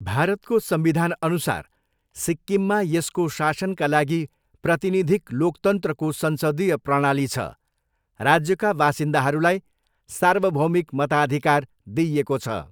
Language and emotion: Nepali, neutral